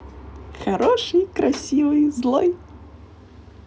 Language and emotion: Russian, positive